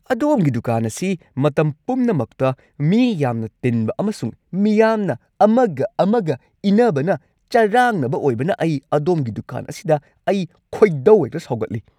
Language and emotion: Manipuri, angry